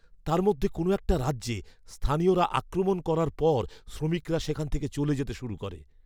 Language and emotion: Bengali, fearful